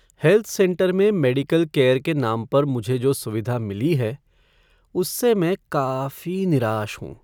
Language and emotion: Hindi, sad